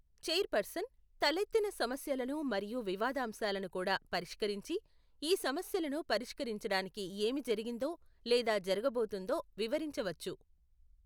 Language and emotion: Telugu, neutral